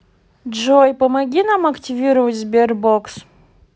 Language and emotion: Russian, neutral